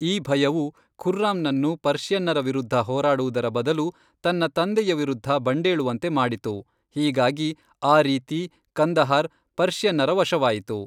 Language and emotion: Kannada, neutral